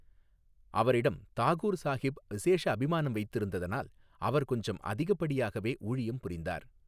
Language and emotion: Tamil, neutral